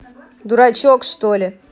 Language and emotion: Russian, angry